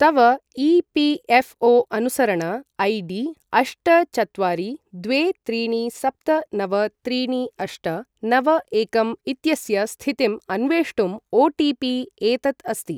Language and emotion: Sanskrit, neutral